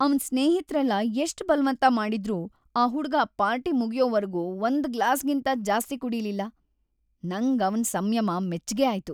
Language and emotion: Kannada, happy